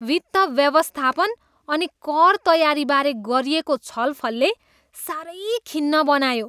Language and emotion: Nepali, disgusted